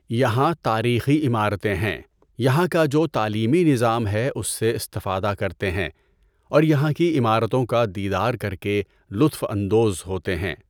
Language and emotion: Urdu, neutral